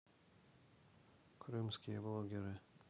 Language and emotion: Russian, neutral